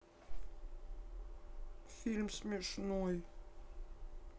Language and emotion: Russian, sad